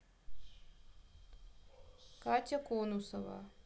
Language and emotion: Russian, neutral